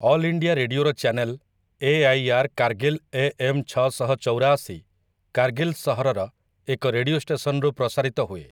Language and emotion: Odia, neutral